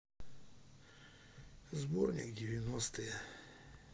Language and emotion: Russian, sad